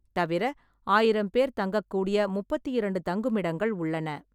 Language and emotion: Tamil, neutral